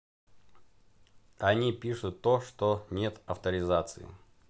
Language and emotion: Russian, neutral